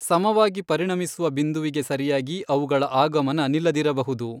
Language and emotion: Kannada, neutral